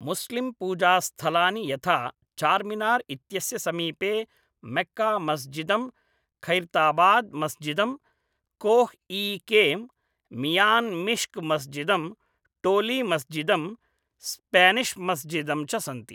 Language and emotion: Sanskrit, neutral